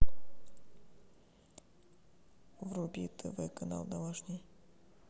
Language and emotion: Russian, neutral